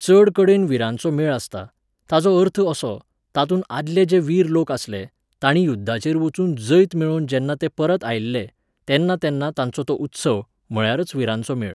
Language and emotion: Goan Konkani, neutral